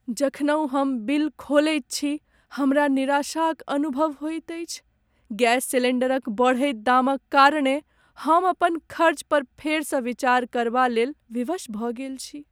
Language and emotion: Maithili, sad